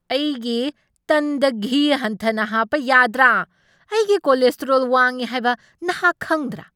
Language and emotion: Manipuri, angry